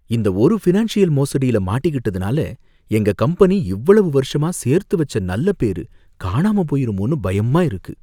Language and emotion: Tamil, fearful